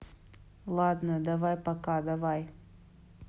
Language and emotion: Russian, neutral